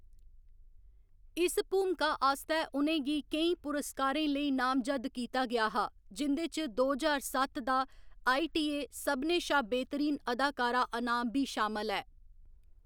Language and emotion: Dogri, neutral